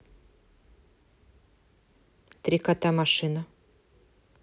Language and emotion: Russian, neutral